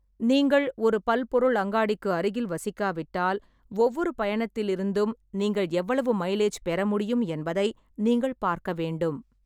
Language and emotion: Tamil, neutral